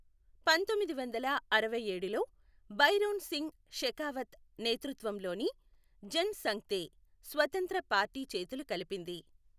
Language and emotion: Telugu, neutral